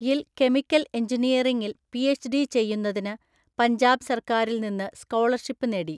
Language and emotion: Malayalam, neutral